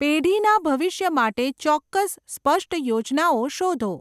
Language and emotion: Gujarati, neutral